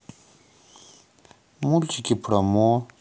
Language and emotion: Russian, neutral